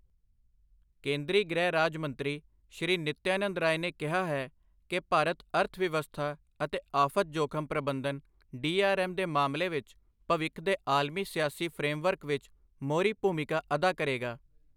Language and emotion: Punjabi, neutral